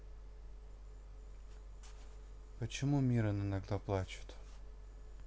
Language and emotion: Russian, neutral